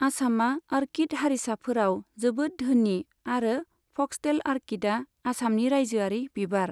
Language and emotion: Bodo, neutral